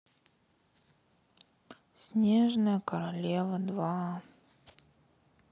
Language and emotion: Russian, sad